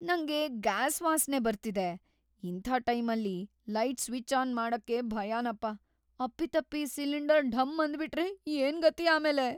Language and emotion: Kannada, fearful